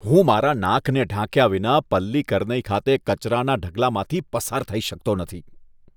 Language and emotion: Gujarati, disgusted